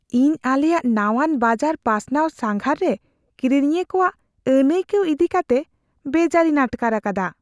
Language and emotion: Santali, fearful